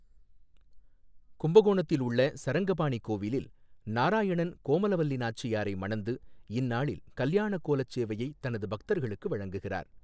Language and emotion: Tamil, neutral